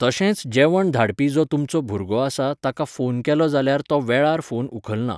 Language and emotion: Goan Konkani, neutral